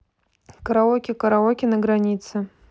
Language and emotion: Russian, neutral